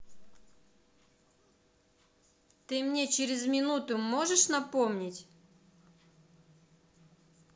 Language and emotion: Russian, angry